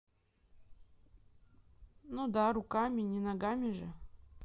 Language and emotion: Russian, neutral